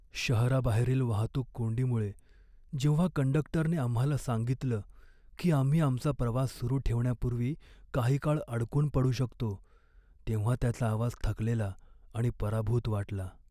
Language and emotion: Marathi, sad